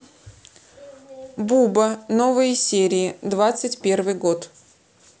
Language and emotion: Russian, neutral